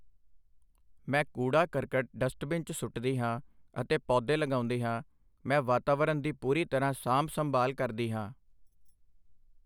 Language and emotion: Punjabi, neutral